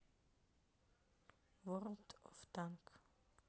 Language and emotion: Russian, neutral